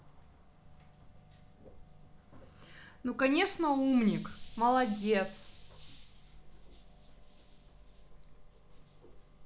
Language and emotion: Russian, positive